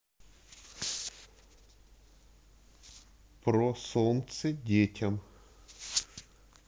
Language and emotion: Russian, neutral